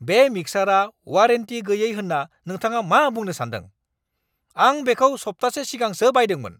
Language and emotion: Bodo, angry